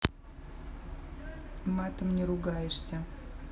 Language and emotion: Russian, neutral